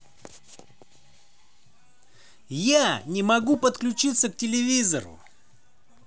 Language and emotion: Russian, positive